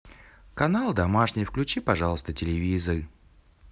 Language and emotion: Russian, positive